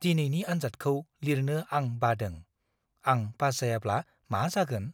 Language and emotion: Bodo, fearful